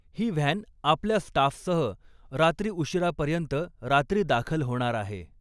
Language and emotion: Marathi, neutral